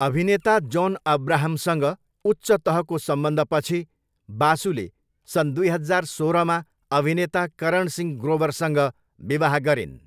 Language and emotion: Nepali, neutral